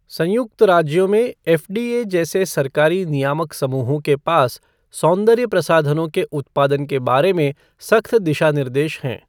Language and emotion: Hindi, neutral